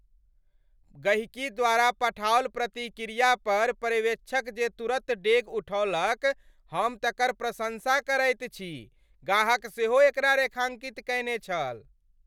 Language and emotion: Maithili, happy